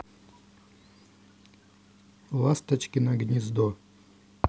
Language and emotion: Russian, neutral